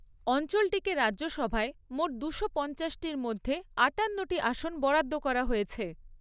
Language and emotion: Bengali, neutral